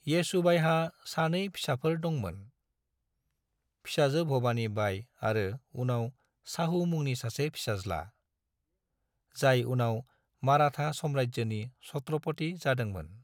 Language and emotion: Bodo, neutral